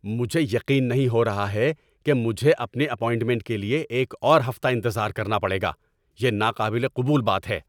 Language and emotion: Urdu, angry